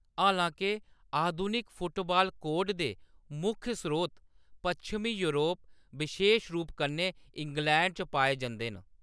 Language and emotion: Dogri, neutral